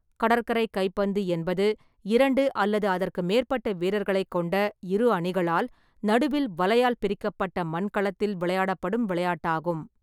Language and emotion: Tamil, neutral